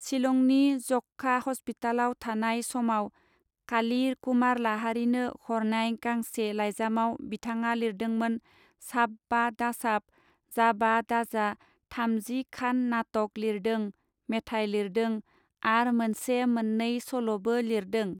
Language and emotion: Bodo, neutral